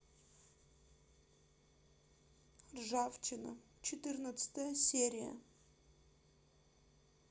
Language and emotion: Russian, sad